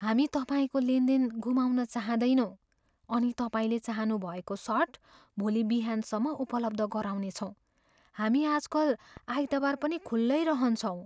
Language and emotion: Nepali, fearful